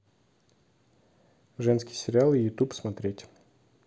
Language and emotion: Russian, neutral